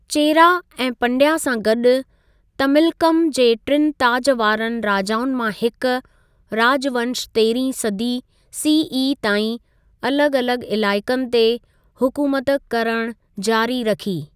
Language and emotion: Sindhi, neutral